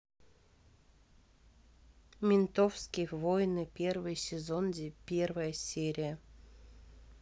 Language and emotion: Russian, neutral